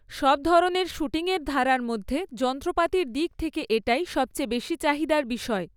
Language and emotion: Bengali, neutral